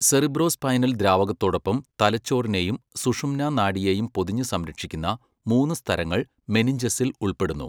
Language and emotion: Malayalam, neutral